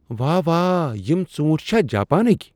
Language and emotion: Kashmiri, surprised